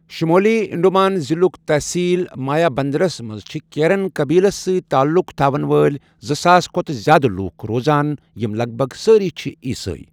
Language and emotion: Kashmiri, neutral